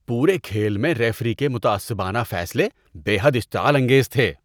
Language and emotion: Urdu, disgusted